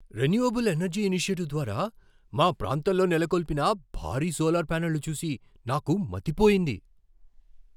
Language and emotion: Telugu, surprised